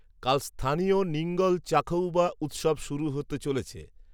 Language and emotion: Bengali, neutral